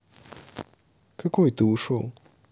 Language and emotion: Russian, neutral